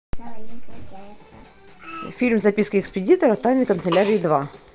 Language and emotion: Russian, neutral